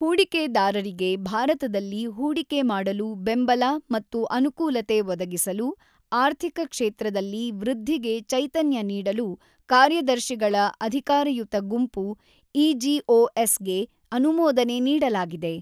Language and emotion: Kannada, neutral